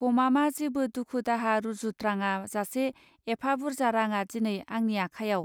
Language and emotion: Bodo, neutral